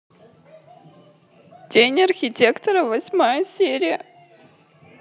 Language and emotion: Russian, sad